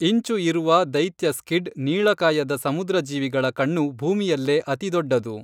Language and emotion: Kannada, neutral